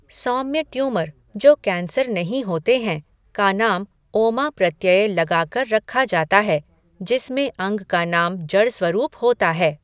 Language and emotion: Hindi, neutral